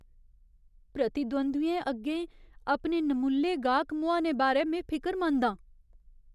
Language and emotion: Dogri, fearful